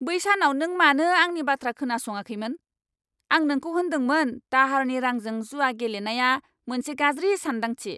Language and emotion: Bodo, angry